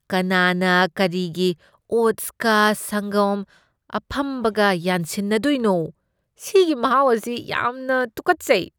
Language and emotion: Manipuri, disgusted